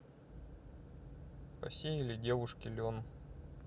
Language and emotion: Russian, neutral